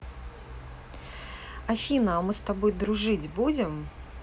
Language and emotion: Russian, neutral